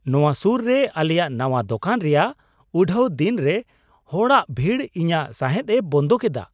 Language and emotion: Santali, surprised